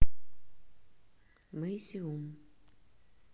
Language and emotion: Russian, neutral